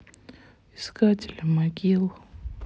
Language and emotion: Russian, sad